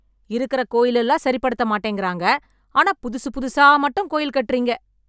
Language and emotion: Tamil, angry